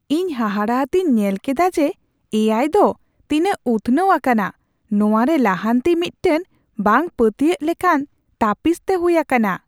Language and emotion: Santali, surprised